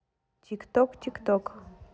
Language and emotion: Russian, neutral